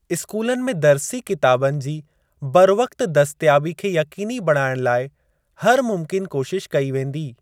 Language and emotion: Sindhi, neutral